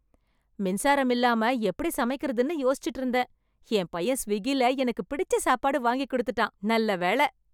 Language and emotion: Tamil, happy